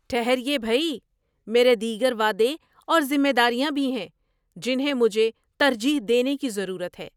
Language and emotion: Urdu, surprised